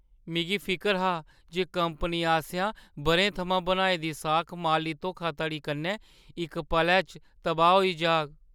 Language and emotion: Dogri, fearful